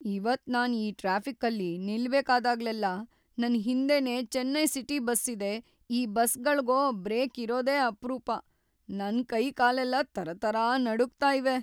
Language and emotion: Kannada, fearful